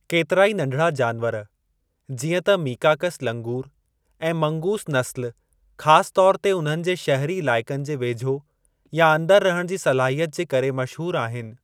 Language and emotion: Sindhi, neutral